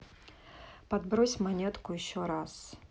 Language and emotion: Russian, neutral